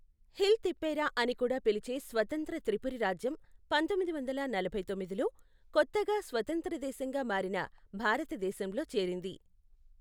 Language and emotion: Telugu, neutral